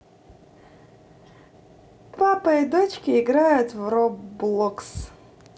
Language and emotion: Russian, positive